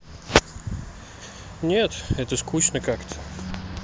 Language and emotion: Russian, neutral